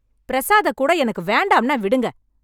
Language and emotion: Tamil, angry